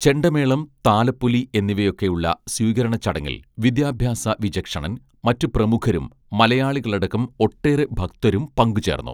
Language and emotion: Malayalam, neutral